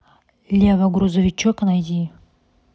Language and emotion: Russian, neutral